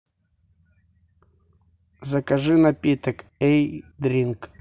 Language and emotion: Russian, neutral